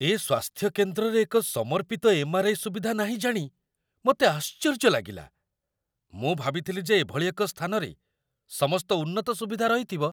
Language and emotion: Odia, surprised